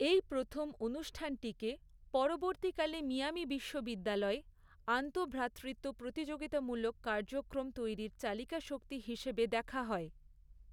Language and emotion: Bengali, neutral